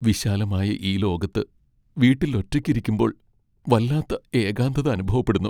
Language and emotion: Malayalam, sad